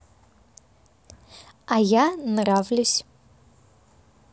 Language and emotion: Russian, positive